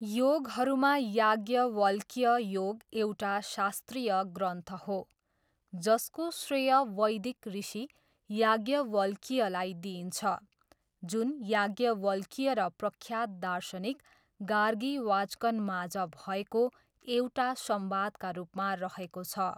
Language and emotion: Nepali, neutral